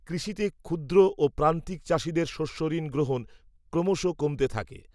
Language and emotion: Bengali, neutral